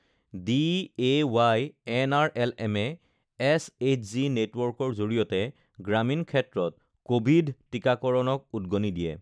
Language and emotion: Assamese, neutral